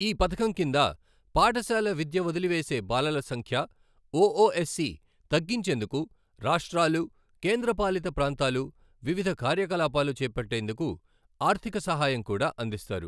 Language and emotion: Telugu, neutral